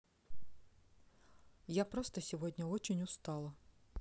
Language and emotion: Russian, sad